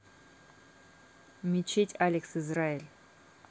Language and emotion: Russian, neutral